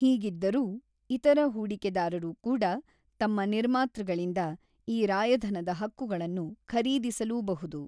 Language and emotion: Kannada, neutral